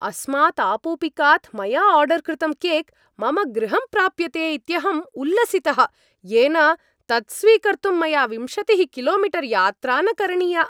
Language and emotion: Sanskrit, happy